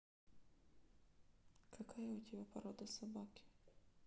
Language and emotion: Russian, neutral